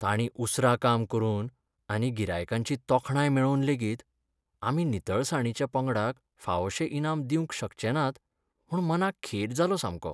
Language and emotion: Goan Konkani, sad